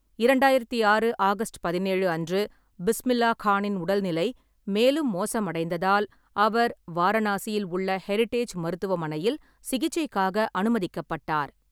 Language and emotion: Tamil, neutral